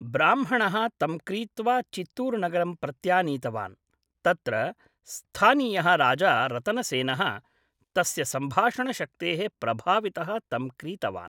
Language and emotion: Sanskrit, neutral